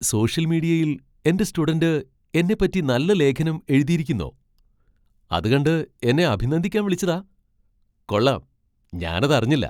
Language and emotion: Malayalam, surprised